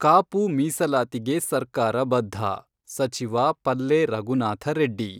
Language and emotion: Kannada, neutral